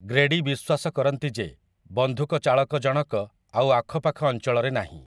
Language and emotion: Odia, neutral